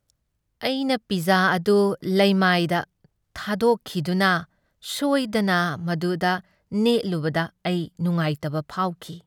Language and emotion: Manipuri, sad